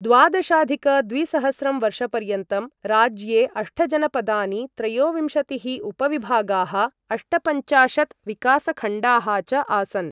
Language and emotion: Sanskrit, neutral